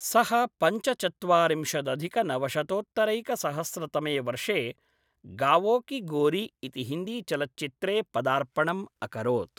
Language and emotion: Sanskrit, neutral